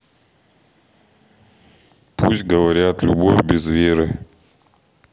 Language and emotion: Russian, neutral